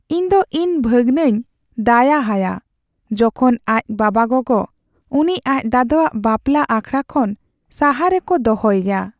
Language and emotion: Santali, sad